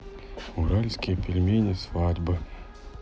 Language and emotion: Russian, neutral